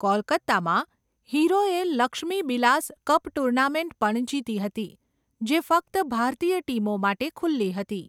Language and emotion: Gujarati, neutral